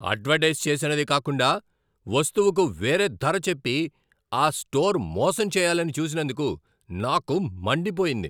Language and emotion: Telugu, angry